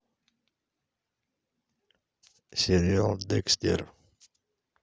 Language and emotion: Russian, neutral